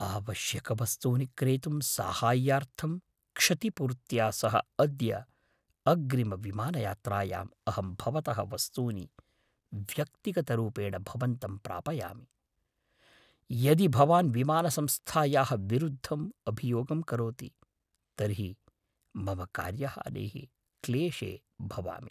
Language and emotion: Sanskrit, fearful